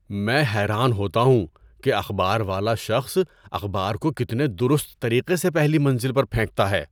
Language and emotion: Urdu, surprised